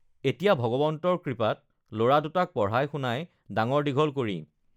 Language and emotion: Assamese, neutral